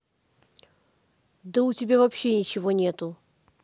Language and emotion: Russian, angry